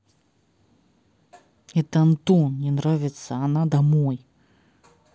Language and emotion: Russian, angry